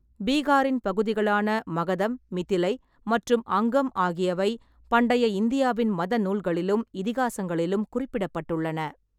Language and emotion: Tamil, neutral